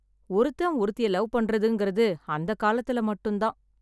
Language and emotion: Tamil, sad